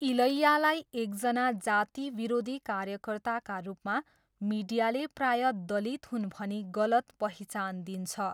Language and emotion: Nepali, neutral